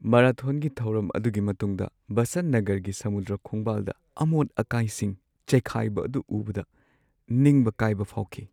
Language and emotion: Manipuri, sad